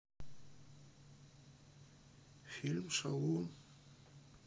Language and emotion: Russian, neutral